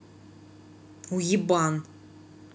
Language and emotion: Russian, angry